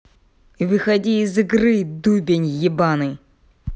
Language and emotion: Russian, angry